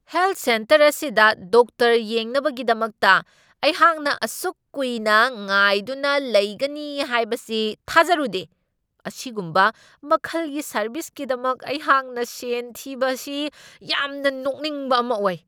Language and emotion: Manipuri, angry